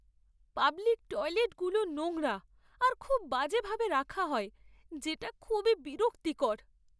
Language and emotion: Bengali, sad